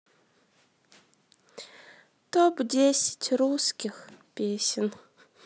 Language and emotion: Russian, sad